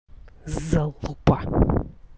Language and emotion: Russian, angry